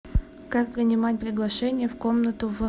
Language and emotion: Russian, neutral